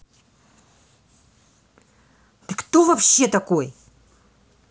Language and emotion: Russian, angry